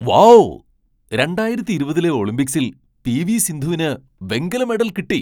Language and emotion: Malayalam, surprised